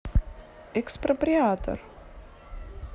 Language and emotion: Russian, neutral